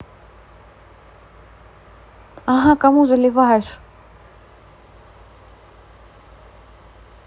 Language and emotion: Russian, neutral